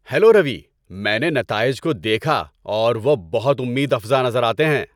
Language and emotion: Urdu, happy